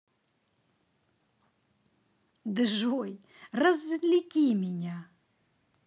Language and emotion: Russian, positive